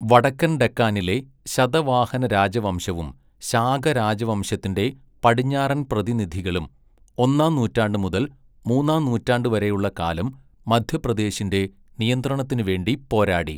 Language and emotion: Malayalam, neutral